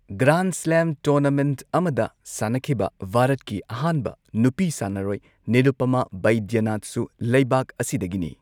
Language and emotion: Manipuri, neutral